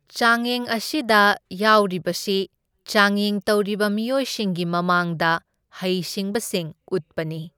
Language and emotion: Manipuri, neutral